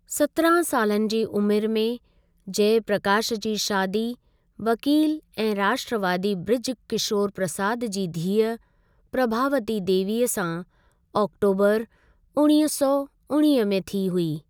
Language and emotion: Sindhi, neutral